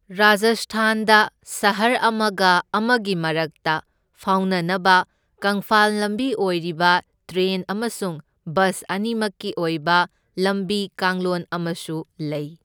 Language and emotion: Manipuri, neutral